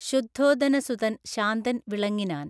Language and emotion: Malayalam, neutral